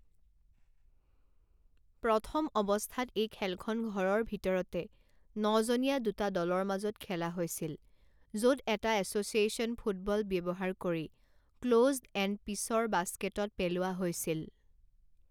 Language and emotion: Assamese, neutral